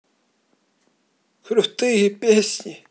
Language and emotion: Russian, neutral